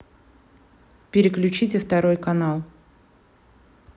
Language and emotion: Russian, neutral